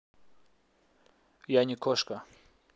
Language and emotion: Russian, neutral